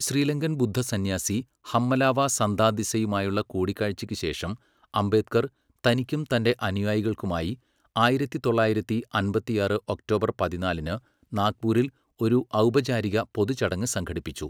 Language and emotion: Malayalam, neutral